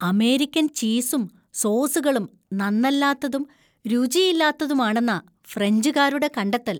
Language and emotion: Malayalam, disgusted